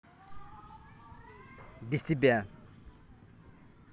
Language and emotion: Russian, angry